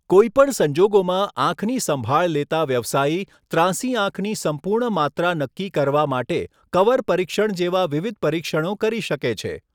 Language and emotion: Gujarati, neutral